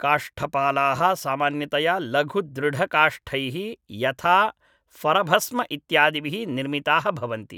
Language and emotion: Sanskrit, neutral